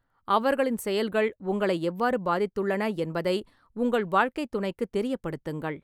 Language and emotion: Tamil, neutral